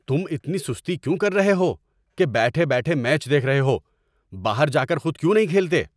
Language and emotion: Urdu, angry